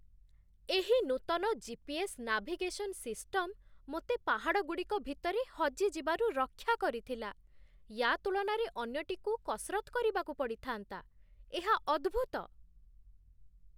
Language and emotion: Odia, surprised